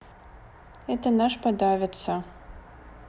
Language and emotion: Russian, neutral